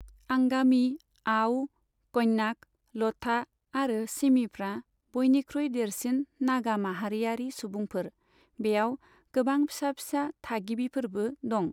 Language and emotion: Bodo, neutral